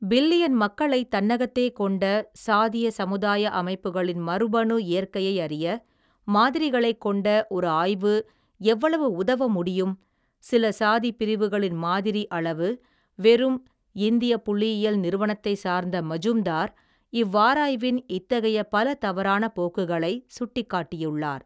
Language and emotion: Tamil, neutral